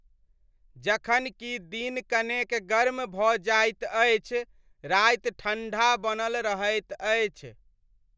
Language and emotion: Maithili, neutral